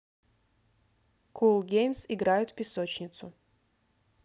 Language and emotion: Russian, neutral